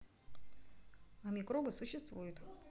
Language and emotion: Russian, neutral